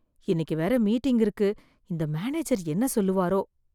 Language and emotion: Tamil, fearful